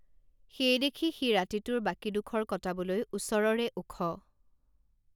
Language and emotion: Assamese, neutral